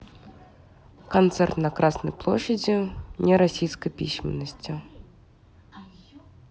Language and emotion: Russian, neutral